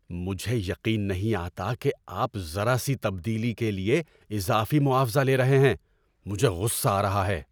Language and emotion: Urdu, angry